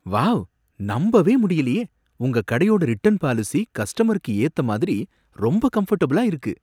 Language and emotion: Tamil, surprised